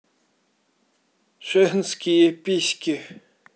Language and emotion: Russian, neutral